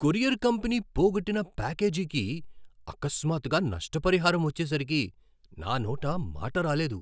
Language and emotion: Telugu, surprised